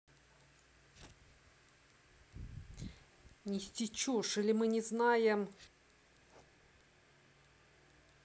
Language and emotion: Russian, angry